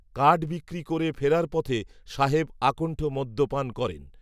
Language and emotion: Bengali, neutral